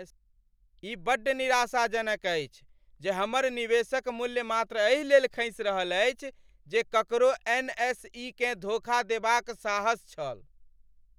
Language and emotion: Maithili, angry